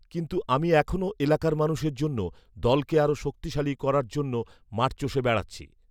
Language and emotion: Bengali, neutral